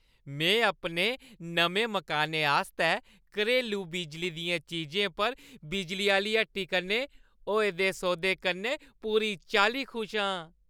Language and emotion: Dogri, happy